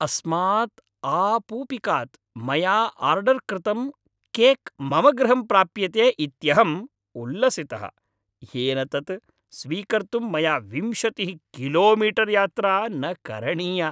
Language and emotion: Sanskrit, happy